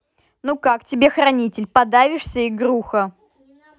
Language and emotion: Russian, angry